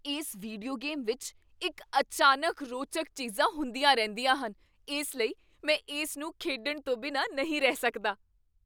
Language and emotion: Punjabi, surprised